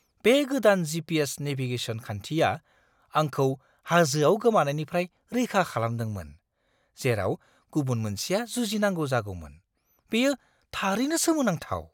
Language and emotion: Bodo, surprised